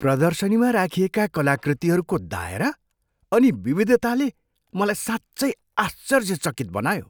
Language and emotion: Nepali, surprised